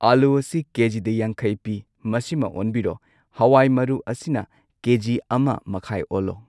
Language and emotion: Manipuri, neutral